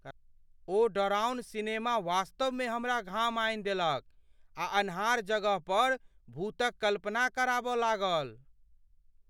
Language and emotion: Maithili, fearful